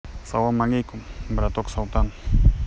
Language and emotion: Russian, neutral